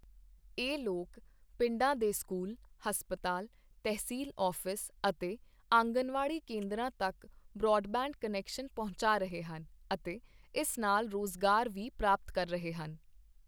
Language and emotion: Punjabi, neutral